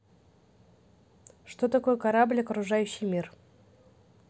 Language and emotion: Russian, neutral